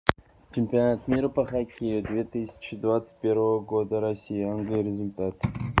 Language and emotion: Russian, neutral